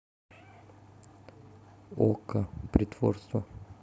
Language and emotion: Russian, neutral